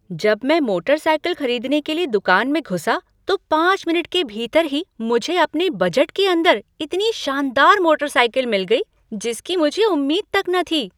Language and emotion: Hindi, surprised